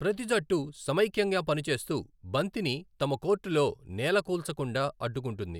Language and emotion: Telugu, neutral